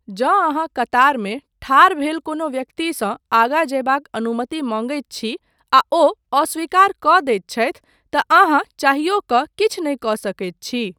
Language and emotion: Maithili, neutral